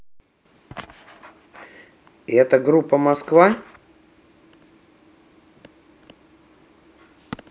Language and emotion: Russian, neutral